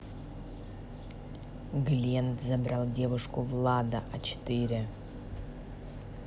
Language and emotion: Russian, neutral